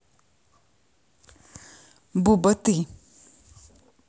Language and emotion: Russian, neutral